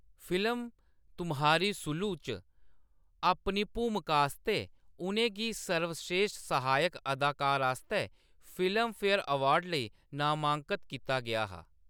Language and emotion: Dogri, neutral